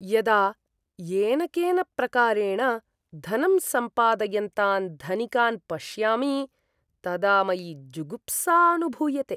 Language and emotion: Sanskrit, disgusted